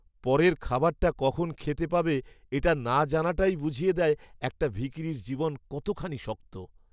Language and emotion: Bengali, sad